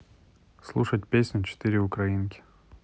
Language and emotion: Russian, neutral